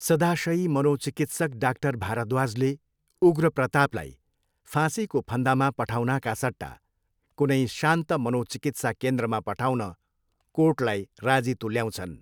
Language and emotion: Nepali, neutral